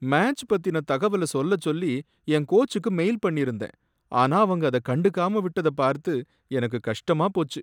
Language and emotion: Tamil, sad